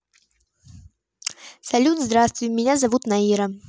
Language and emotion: Russian, positive